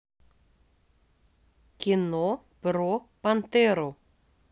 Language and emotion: Russian, neutral